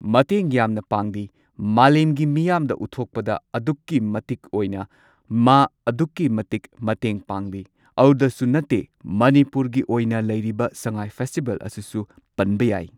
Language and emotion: Manipuri, neutral